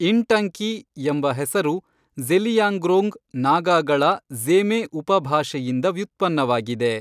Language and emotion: Kannada, neutral